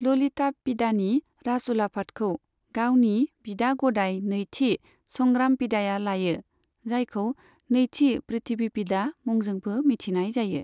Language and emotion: Bodo, neutral